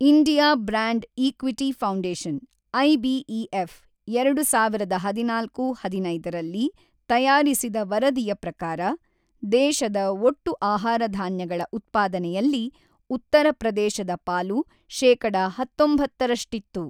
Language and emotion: Kannada, neutral